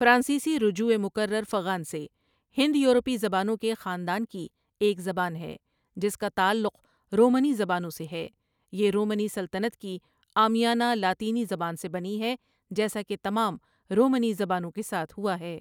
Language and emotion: Urdu, neutral